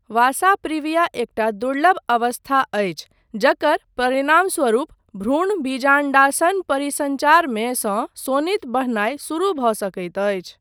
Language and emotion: Maithili, neutral